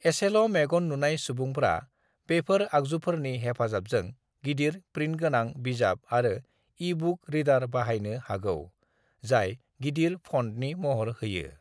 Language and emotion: Bodo, neutral